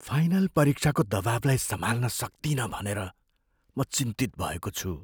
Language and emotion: Nepali, fearful